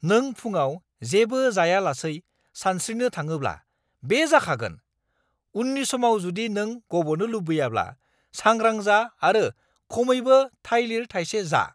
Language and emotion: Bodo, angry